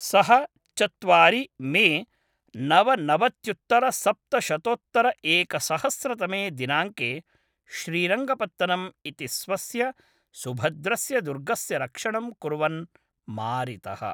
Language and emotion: Sanskrit, neutral